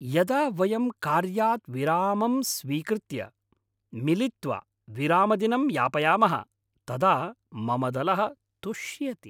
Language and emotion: Sanskrit, happy